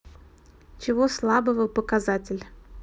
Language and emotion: Russian, neutral